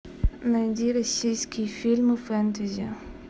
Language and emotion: Russian, neutral